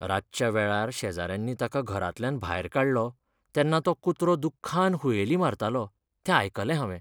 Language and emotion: Goan Konkani, sad